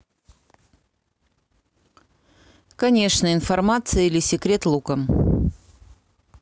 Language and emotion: Russian, neutral